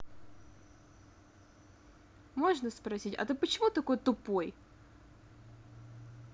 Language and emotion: Russian, angry